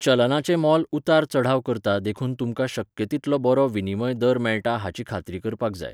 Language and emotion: Goan Konkani, neutral